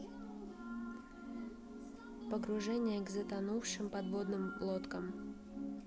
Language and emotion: Russian, neutral